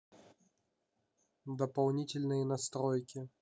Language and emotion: Russian, neutral